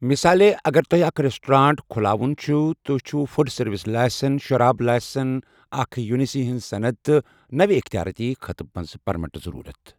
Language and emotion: Kashmiri, neutral